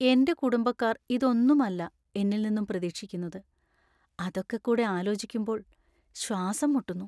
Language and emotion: Malayalam, sad